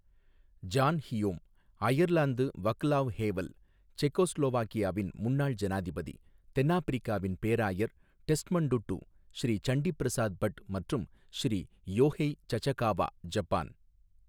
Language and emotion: Tamil, neutral